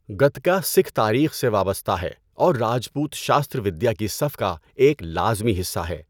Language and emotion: Urdu, neutral